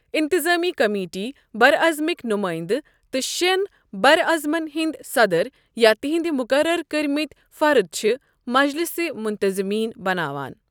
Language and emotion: Kashmiri, neutral